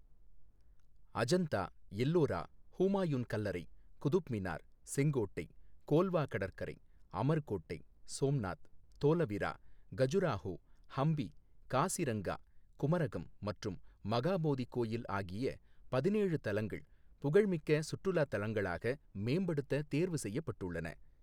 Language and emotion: Tamil, neutral